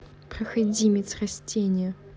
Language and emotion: Russian, angry